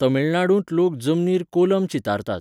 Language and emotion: Goan Konkani, neutral